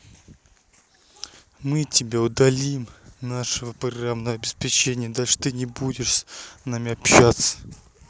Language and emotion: Russian, angry